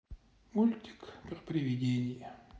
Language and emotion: Russian, sad